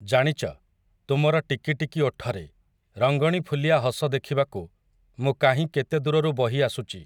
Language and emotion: Odia, neutral